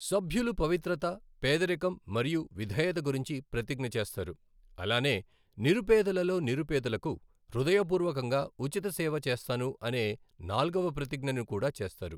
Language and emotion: Telugu, neutral